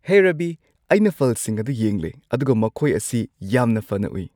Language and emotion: Manipuri, happy